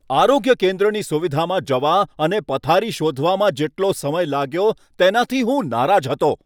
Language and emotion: Gujarati, angry